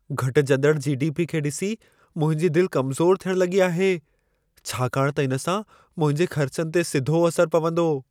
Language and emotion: Sindhi, fearful